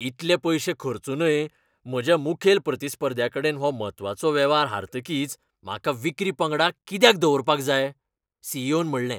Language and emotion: Goan Konkani, angry